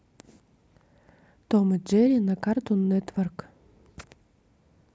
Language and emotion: Russian, neutral